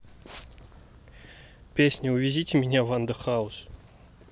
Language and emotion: Russian, neutral